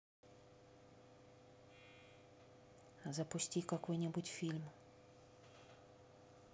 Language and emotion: Russian, neutral